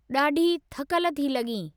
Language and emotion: Sindhi, neutral